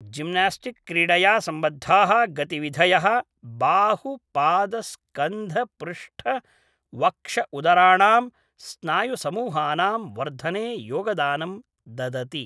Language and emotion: Sanskrit, neutral